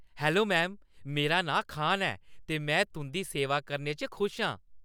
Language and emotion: Dogri, happy